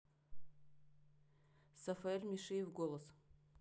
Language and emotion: Russian, neutral